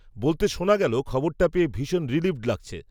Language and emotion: Bengali, neutral